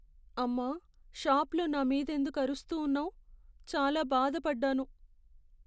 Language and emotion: Telugu, sad